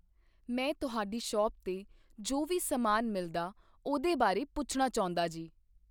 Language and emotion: Punjabi, neutral